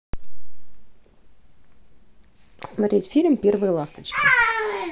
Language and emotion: Russian, neutral